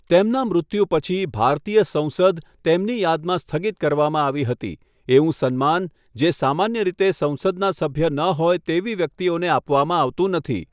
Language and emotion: Gujarati, neutral